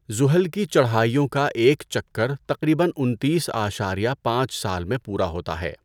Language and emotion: Urdu, neutral